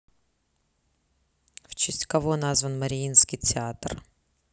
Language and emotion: Russian, neutral